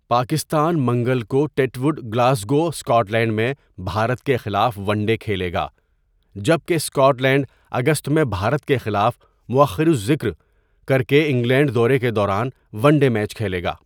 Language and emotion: Urdu, neutral